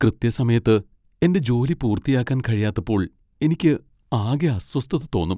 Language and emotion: Malayalam, sad